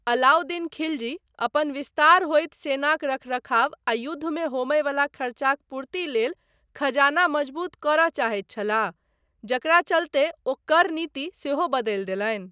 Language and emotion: Maithili, neutral